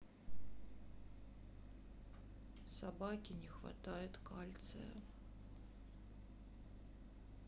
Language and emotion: Russian, sad